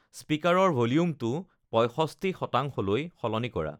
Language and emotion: Assamese, neutral